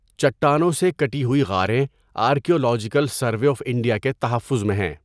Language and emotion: Urdu, neutral